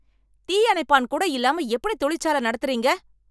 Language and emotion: Tamil, angry